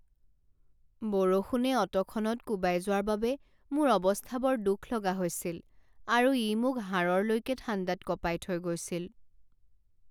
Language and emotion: Assamese, sad